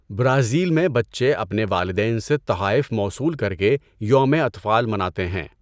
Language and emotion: Urdu, neutral